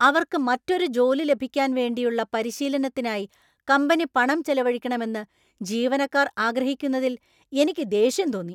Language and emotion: Malayalam, angry